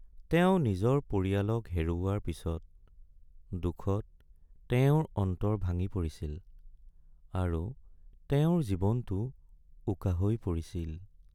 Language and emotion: Assamese, sad